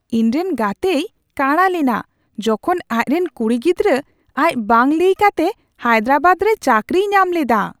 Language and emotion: Santali, surprised